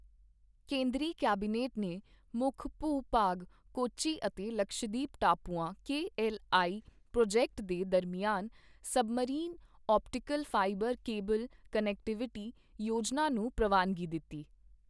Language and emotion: Punjabi, neutral